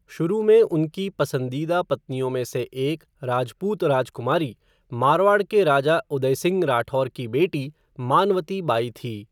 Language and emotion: Hindi, neutral